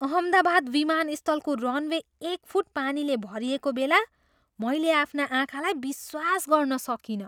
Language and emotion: Nepali, surprised